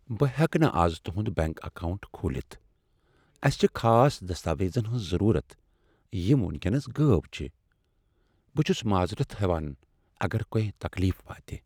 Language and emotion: Kashmiri, sad